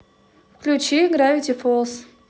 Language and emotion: Russian, neutral